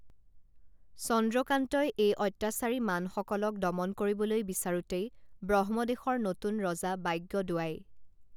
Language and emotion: Assamese, neutral